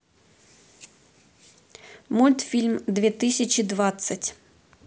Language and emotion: Russian, neutral